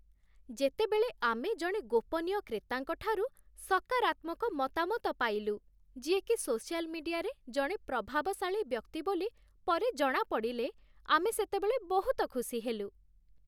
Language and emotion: Odia, happy